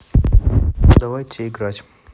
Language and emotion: Russian, neutral